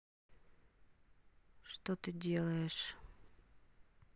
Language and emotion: Russian, neutral